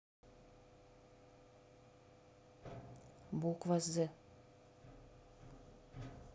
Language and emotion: Russian, neutral